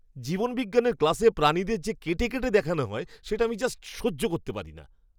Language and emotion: Bengali, disgusted